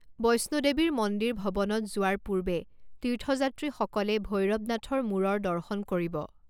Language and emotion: Assamese, neutral